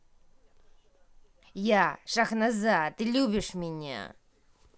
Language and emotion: Russian, angry